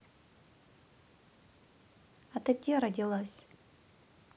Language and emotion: Russian, neutral